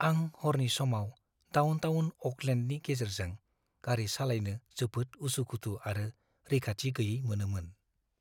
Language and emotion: Bodo, fearful